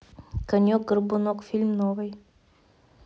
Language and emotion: Russian, neutral